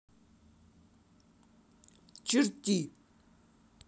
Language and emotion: Russian, angry